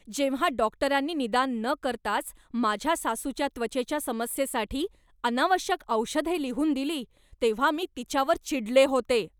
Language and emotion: Marathi, angry